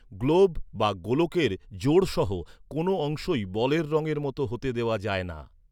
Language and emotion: Bengali, neutral